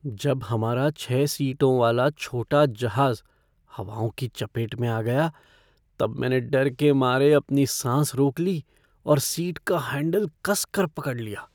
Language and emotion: Hindi, fearful